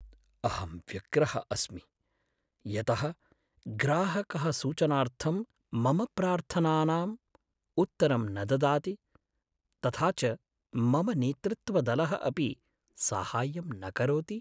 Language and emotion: Sanskrit, sad